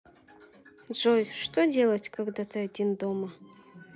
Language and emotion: Russian, sad